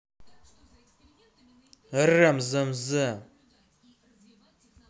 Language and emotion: Russian, angry